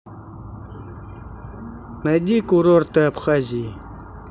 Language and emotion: Russian, neutral